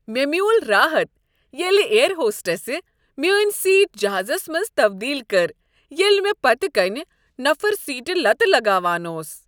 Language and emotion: Kashmiri, happy